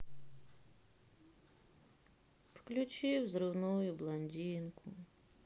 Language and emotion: Russian, sad